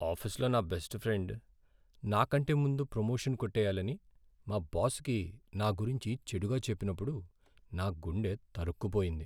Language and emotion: Telugu, sad